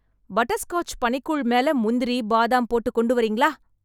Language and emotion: Tamil, happy